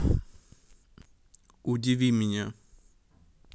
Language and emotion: Russian, neutral